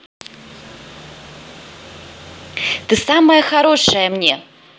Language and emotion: Russian, positive